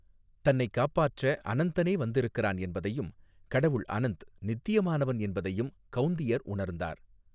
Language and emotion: Tamil, neutral